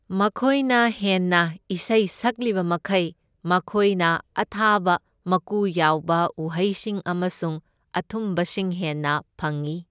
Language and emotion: Manipuri, neutral